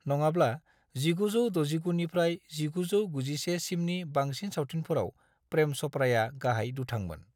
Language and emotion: Bodo, neutral